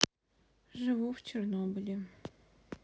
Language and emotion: Russian, sad